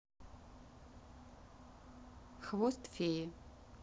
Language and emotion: Russian, neutral